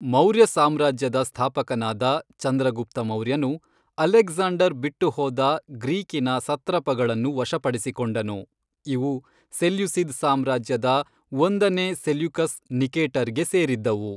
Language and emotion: Kannada, neutral